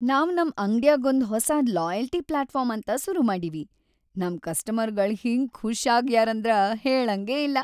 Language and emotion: Kannada, happy